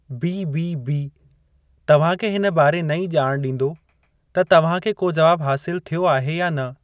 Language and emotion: Sindhi, neutral